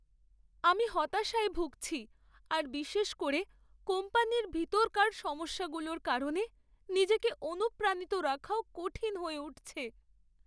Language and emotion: Bengali, sad